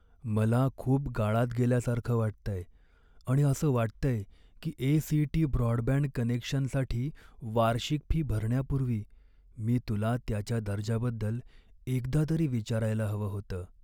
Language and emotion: Marathi, sad